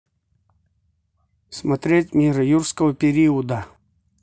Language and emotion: Russian, neutral